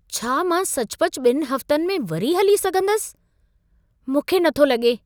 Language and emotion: Sindhi, surprised